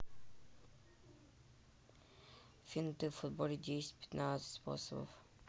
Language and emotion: Russian, neutral